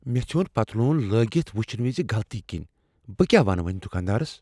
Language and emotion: Kashmiri, fearful